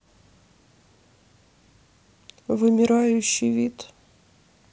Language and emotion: Russian, sad